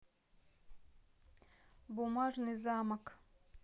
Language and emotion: Russian, neutral